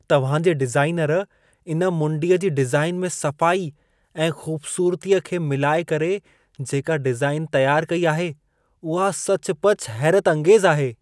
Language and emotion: Sindhi, surprised